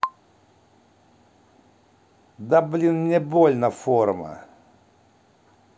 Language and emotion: Russian, angry